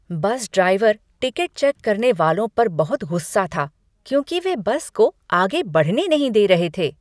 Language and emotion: Hindi, angry